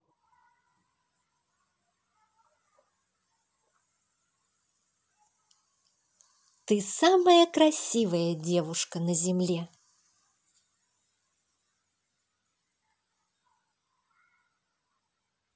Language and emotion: Russian, positive